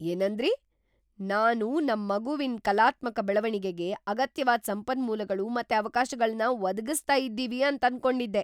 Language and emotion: Kannada, surprised